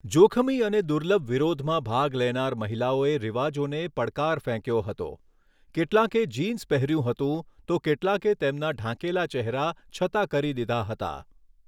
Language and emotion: Gujarati, neutral